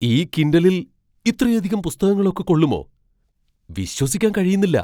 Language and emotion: Malayalam, surprised